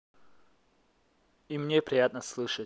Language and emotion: Russian, positive